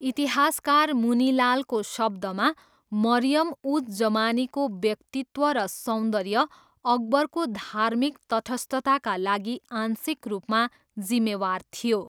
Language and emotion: Nepali, neutral